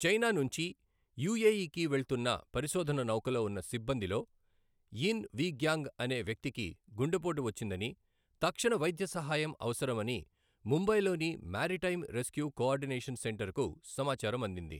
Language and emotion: Telugu, neutral